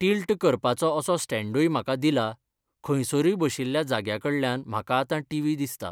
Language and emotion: Goan Konkani, neutral